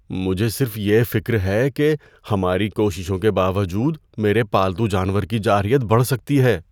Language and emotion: Urdu, fearful